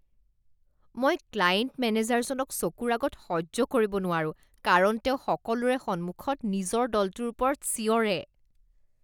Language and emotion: Assamese, disgusted